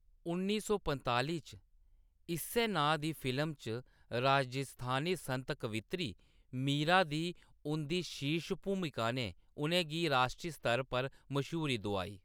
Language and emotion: Dogri, neutral